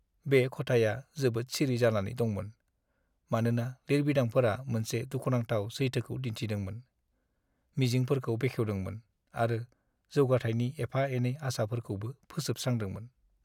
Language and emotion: Bodo, sad